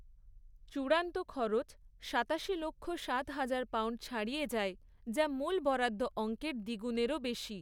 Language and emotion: Bengali, neutral